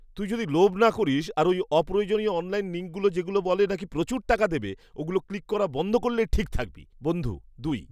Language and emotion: Bengali, disgusted